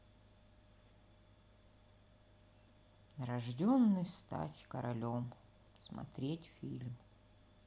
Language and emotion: Russian, sad